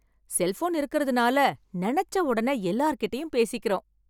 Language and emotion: Tamil, happy